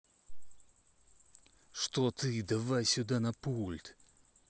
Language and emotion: Russian, angry